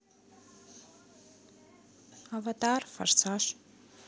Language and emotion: Russian, neutral